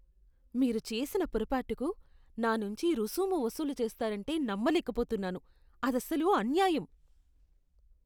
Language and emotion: Telugu, disgusted